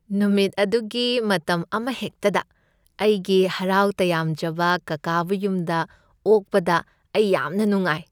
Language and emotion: Manipuri, happy